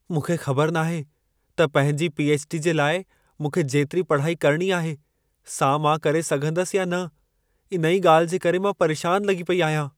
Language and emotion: Sindhi, fearful